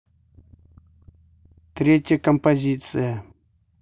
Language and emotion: Russian, neutral